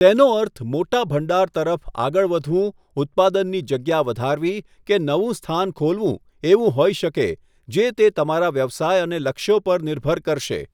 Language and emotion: Gujarati, neutral